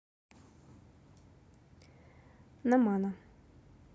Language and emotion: Russian, neutral